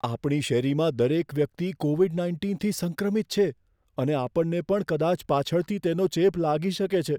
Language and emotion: Gujarati, fearful